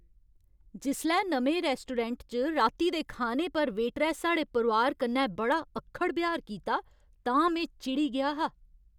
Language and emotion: Dogri, angry